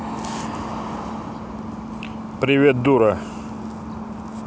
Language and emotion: Russian, neutral